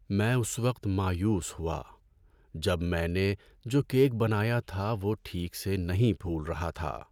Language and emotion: Urdu, sad